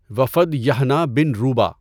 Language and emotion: Urdu, neutral